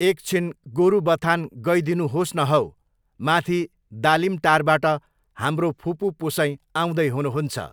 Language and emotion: Nepali, neutral